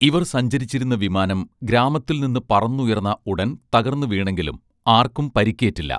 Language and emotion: Malayalam, neutral